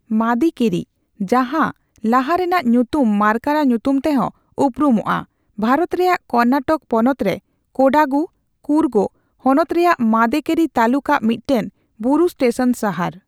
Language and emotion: Santali, neutral